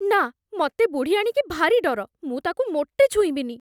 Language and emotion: Odia, fearful